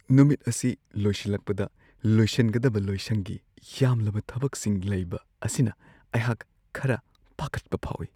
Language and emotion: Manipuri, fearful